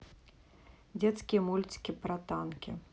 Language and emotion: Russian, neutral